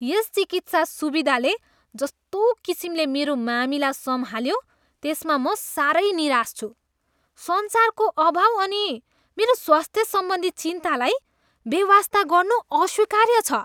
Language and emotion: Nepali, disgusted